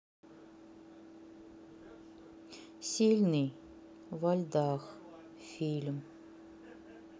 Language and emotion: Russian, neutral